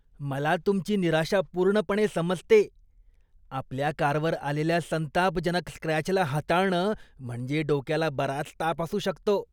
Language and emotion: Marathi, disgusted